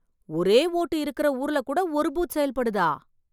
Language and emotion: Tamil, surprised